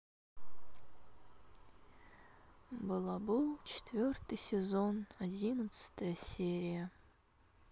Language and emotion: Russian, sad